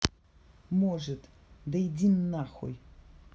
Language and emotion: Russian, angry